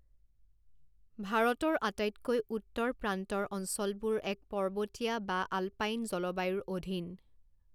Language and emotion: Assamese, neutral